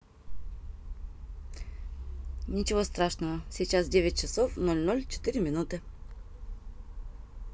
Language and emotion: Russian, positive